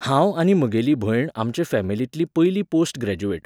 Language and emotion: Goan Konkani, neutral